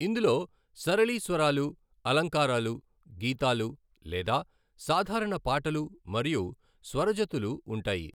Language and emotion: Telugu, neutral